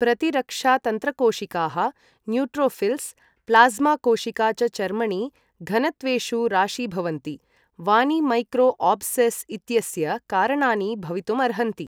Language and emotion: Sanskrit, neutral